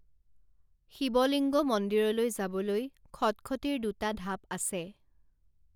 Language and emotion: Assamese, neutral